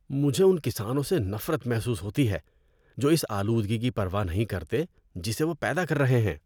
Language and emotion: Urdu, disgusted